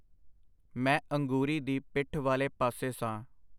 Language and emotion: Punjabi, neutral